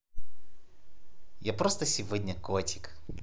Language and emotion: Russian, positive